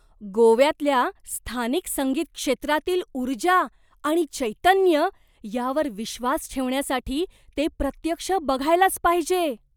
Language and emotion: Marathi, surprised